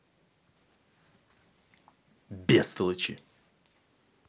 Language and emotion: Russian, angry